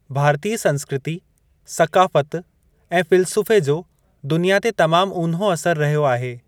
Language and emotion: Sindhi, neutral